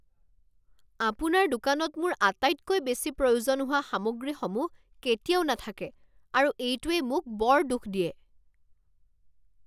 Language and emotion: Assamese, angry